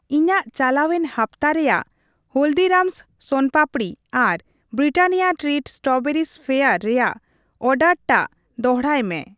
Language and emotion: Santali, neutral